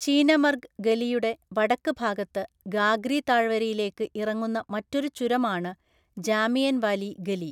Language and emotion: Malayalam, neutral